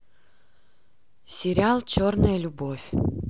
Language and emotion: Russian, neutral